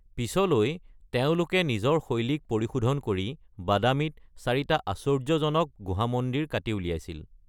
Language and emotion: Assamese, neutral